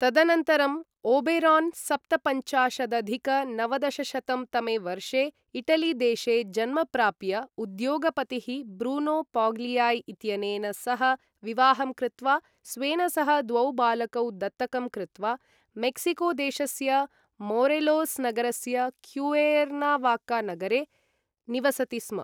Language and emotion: Sanskrit, neutral